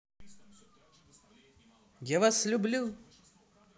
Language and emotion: Russian, positive